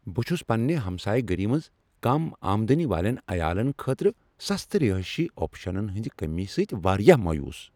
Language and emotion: Kashmiri, angry